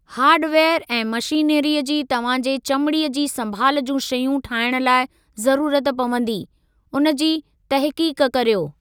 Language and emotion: Sindhi, neutral